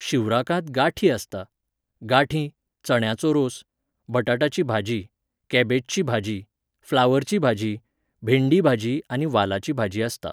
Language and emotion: Goan Konkani, neutral